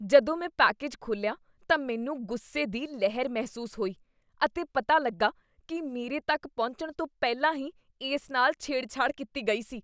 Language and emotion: Punjabi, disgusted